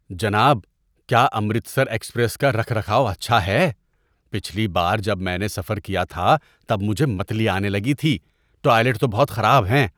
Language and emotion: Urdu, disgusted